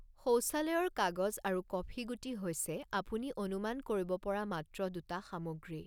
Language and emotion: Assamese, neutral